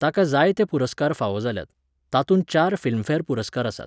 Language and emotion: Goan Konkani, neutral